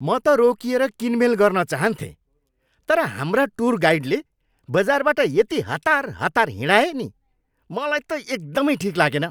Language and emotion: Nepali, angry